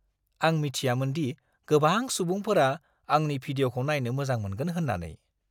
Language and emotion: Bodo, surprised